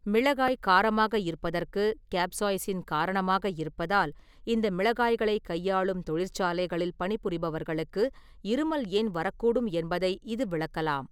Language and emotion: Tamil, neutral